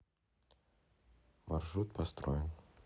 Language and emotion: Russian, neutral